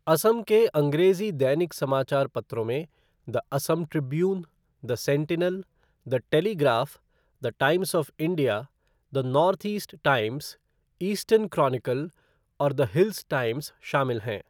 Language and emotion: Hindi, neutral